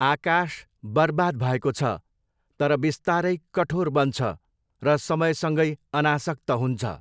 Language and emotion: Nepali, neutral